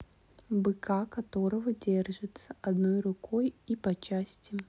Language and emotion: Russian, neutral